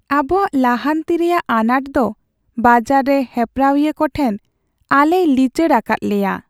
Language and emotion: Santali, sad